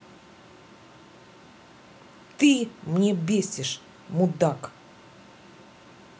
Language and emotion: Russian, angry